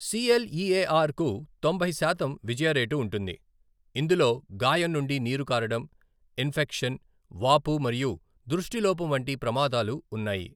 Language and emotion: Telugu, neutral